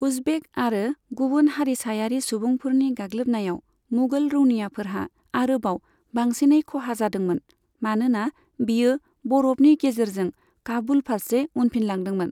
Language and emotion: Bodo, neutral